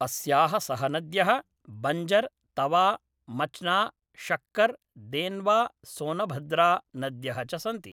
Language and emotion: Sanskrit, neutral